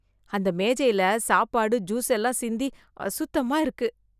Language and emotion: Tamil, disgusted